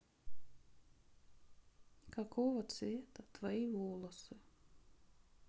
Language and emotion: Russian, sad